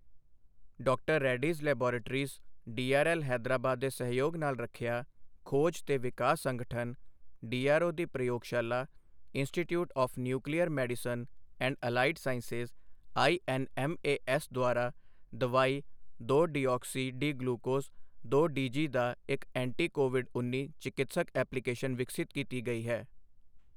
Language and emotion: Punjabi, neutral